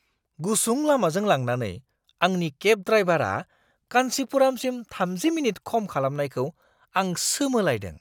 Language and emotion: Bodo, surprised